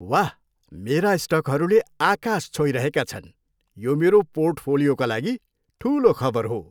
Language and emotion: Nepali, happy